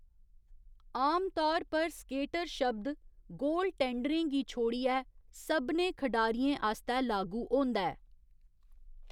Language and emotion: Dogri, neutral